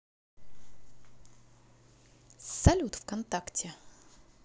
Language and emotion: Russian, neutral